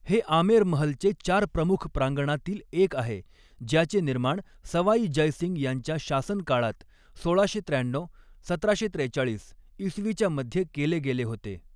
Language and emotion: Marathi, neutral